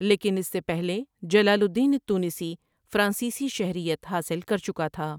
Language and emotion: Urdu, neutral